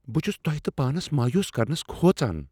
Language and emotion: Kashmiri, fearful